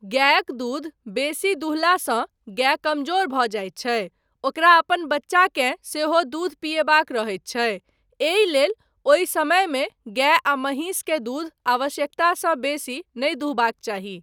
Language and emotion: Maithili, neutral